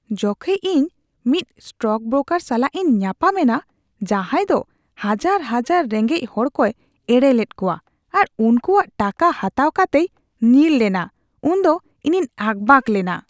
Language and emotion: Santali, disgusted